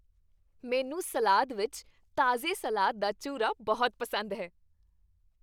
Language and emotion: Punjabi, happy